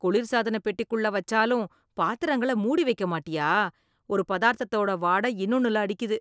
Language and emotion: Tamil, disgusted